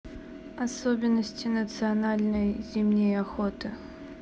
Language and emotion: Russian, neutral